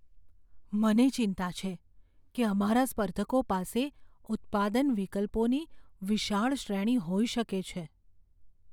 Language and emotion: Gujarati, fearful